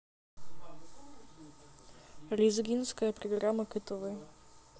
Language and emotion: Russian, neutral